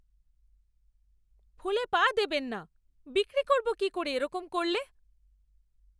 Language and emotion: Bengali, angry